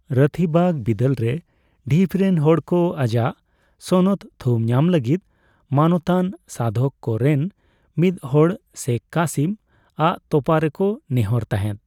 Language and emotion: Santali, neutral